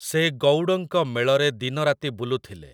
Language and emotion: Odia, neutral